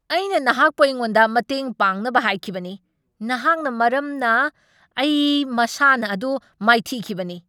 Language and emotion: Manipuri, angry